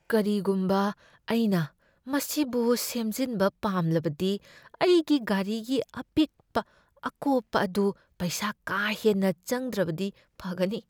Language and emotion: Manipuri, fearful